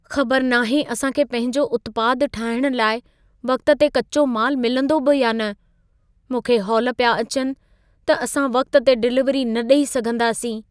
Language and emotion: Sindhi, fearful